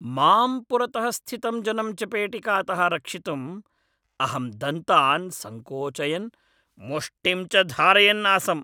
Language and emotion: Sanskrit, angry